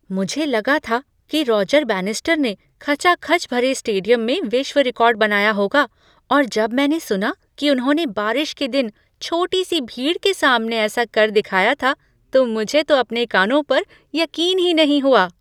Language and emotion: Hindi, surprised